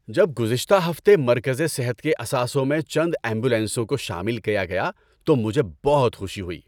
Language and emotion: Urdu, happy